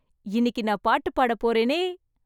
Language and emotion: Tamil, happy